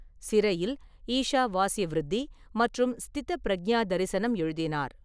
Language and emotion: Tamil, neutral